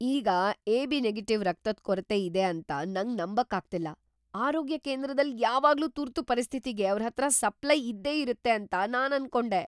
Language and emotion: Kannada, surprised